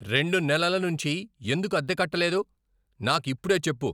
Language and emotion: Telugu, angry